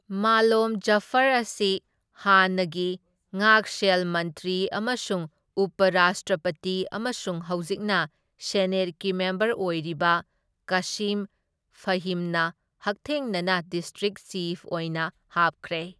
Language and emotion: Manipuri, neutral